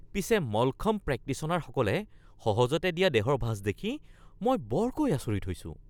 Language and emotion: Assamese, surprised